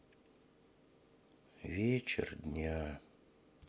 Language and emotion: Russian, sad